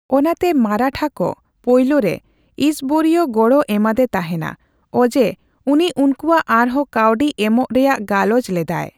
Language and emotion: Santali, neutral